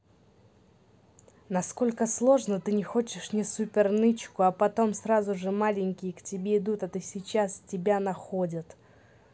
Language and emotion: Russian, neutral